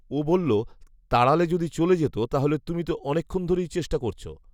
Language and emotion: Bengali, neutral